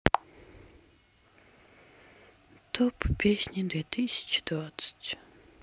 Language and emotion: Russian, sad